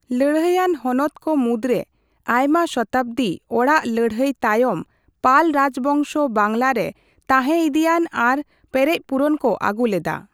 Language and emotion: Santali, neutral